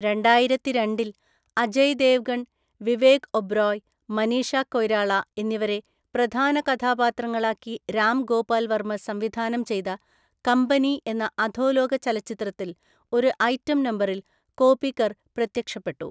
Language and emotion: Malayalam, neutral